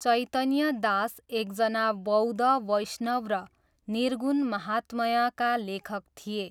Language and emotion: Nepali, neutral